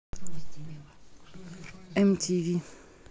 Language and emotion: Russian, neutral